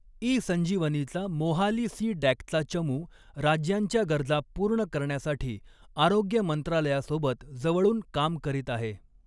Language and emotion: Marathi, neutral